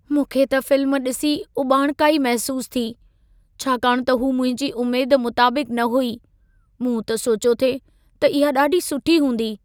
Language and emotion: Sindhi, sad